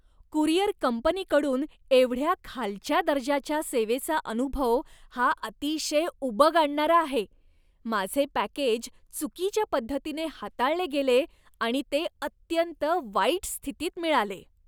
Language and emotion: Marathi, disgusted